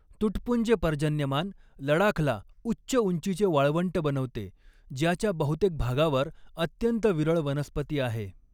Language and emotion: Marathi, neutral